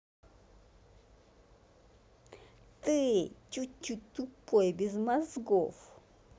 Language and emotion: Russian, angry